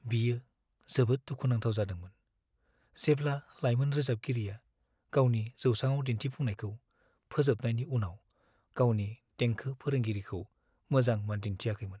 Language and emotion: Bodo, sad